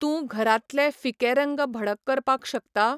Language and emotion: Goan Konkani, neutral